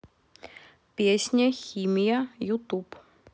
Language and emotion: Russian, neutral